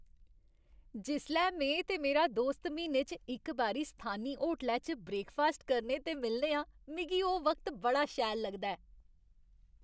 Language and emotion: Dogri, happy